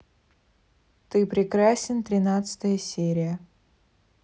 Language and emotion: Russian, neutral